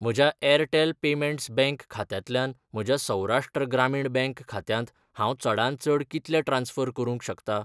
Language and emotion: Goan Konkani, neutral